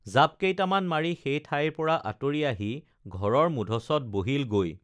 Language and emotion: Assamese, neutral